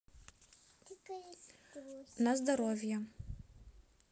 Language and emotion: Russian, neutral